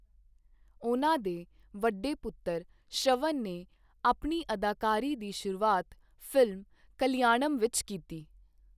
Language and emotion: Punjabi, neutral